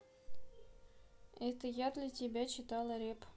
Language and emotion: Russian, neutral